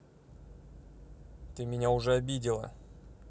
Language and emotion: Russian, angry